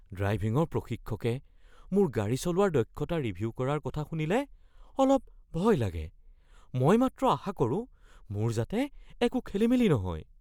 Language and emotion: Assamese, fearful